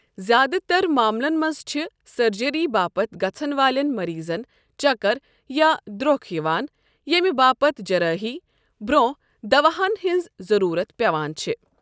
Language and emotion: Kashmiri, neutral